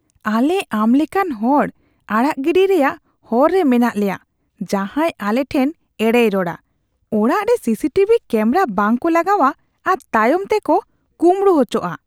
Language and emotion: Santali, disgusted